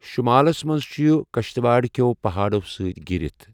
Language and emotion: Kashmiri, neutral